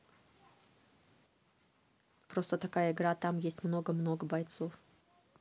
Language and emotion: Russian, neutral